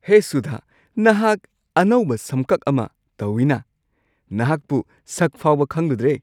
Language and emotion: Manipuri, surprised